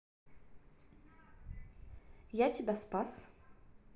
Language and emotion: Russian, neutral